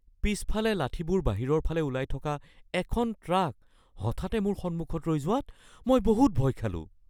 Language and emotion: Assamese, fearful